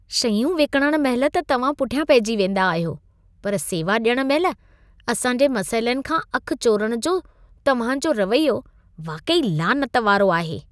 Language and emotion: Sindhi, disgusted